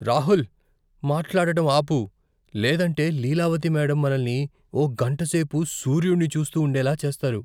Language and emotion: Telugu, fearful